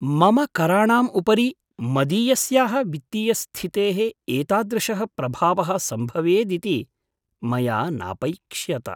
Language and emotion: Sanskrit, surprised